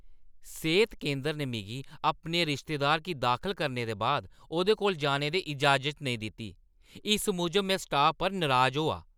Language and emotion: Dogri, angry